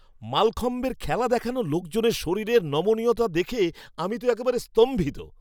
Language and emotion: Bengali, surprised